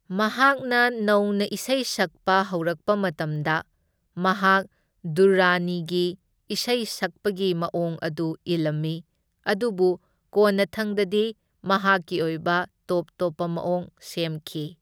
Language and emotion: Manipuri, neutral